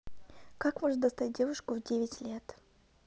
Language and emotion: Russian, neutral